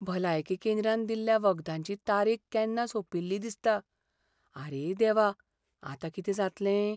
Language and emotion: Goan Konkani, fearful